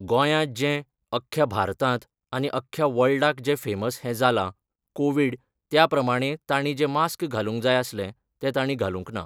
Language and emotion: Goan Konkani, neutral